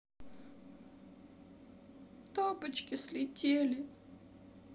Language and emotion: Russian, sad